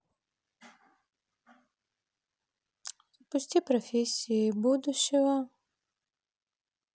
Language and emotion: Russian, neutral